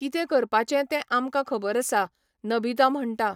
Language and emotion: Goan Konkani, neutral